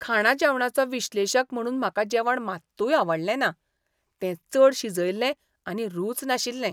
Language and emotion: Goan Konkani, disgusted